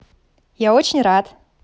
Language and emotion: Russian, positive